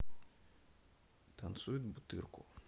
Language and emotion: Russian, neutral